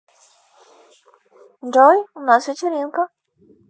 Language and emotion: Russian, positive